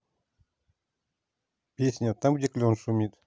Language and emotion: Russian, neutral